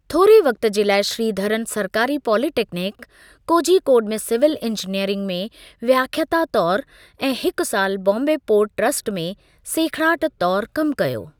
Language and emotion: Sindhi, neutral